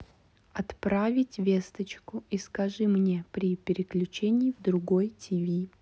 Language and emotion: Russian, neutral